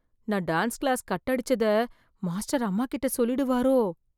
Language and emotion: Tamil, fearful